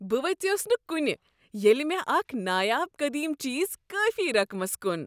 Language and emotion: Kashmiri, happy